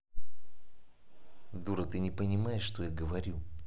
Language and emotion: Russian, angry